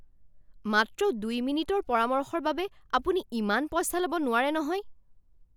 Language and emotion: Assamese, angry